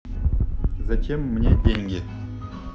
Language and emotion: Russian, neutral